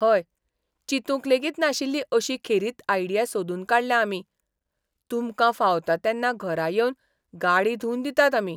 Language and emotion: Goan Konkani, surprised